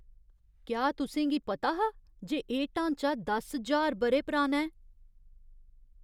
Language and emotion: Dogri, surprised